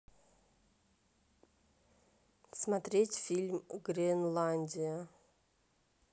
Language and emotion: Russian, neutral